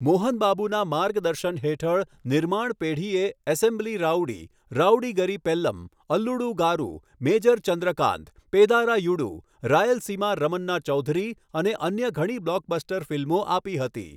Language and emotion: Gujarati, neutral